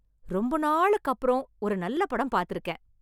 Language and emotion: Tamil, happy